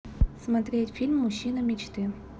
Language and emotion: Russian, neutral